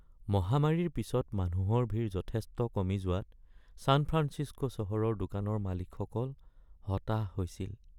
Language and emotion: Assamese, sad